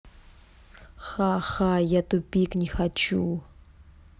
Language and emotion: Russian, neutral